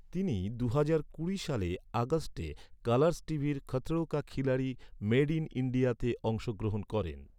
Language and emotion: Bengali, neutral